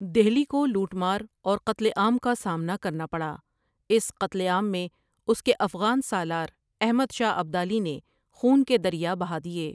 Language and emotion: Urdu, neutral